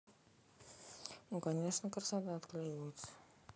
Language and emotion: Russian, neutral